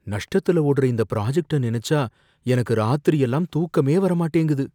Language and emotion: Tamil, fearful